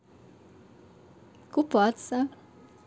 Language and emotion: Russian, positive